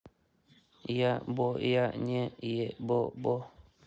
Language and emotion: Russian, neutral